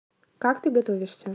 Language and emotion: Russian, neutral